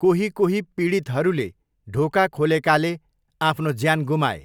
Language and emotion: Nepali, neutral